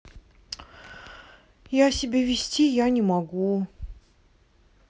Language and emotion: Russian, sad